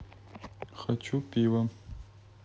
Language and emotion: Russian, neutral